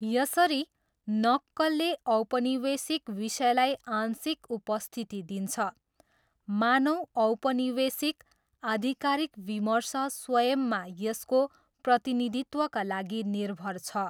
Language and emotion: Nepali, neutral